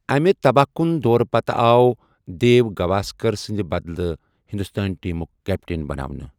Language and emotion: Kashmiri, neutral